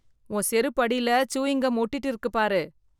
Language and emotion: Tamil, disgusted